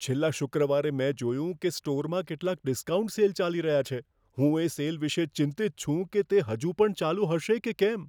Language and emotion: Gujarati, fearful